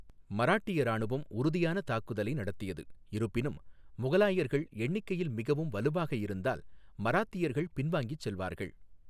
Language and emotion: Tamil, neutral